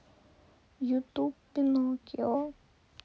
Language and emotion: Russian, sad